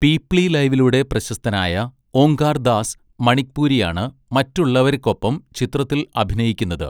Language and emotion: Malayalam, neutral